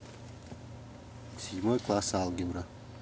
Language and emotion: Russian, neutral